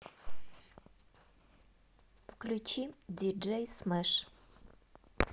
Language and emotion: Russian, neutral